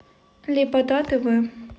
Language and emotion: Russian, neutral